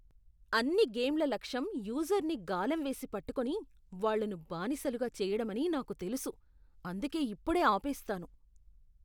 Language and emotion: Telugu, disgusted